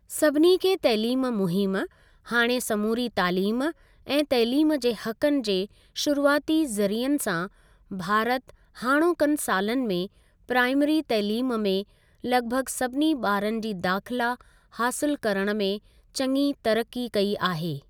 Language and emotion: Sindhi, neutral